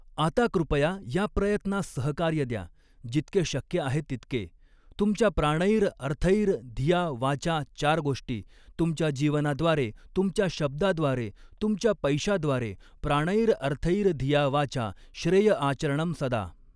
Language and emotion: Marathi, neutral